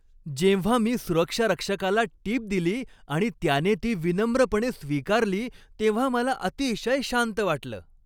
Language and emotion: Marathi, happy